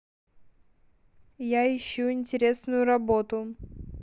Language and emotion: Russian, neutral